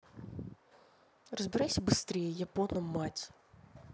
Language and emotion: Russian, angry